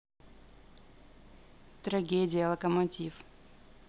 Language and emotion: Russian, neutral